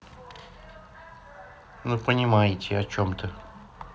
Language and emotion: Russian, neutral